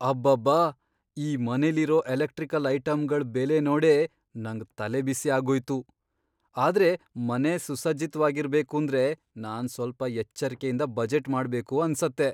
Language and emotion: Kannada, surprised